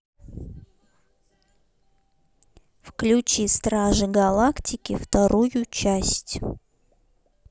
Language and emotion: Russian, neutral